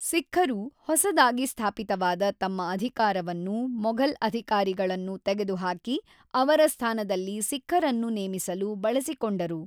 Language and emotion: Kannada, neutral